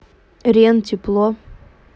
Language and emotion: Russian, neutral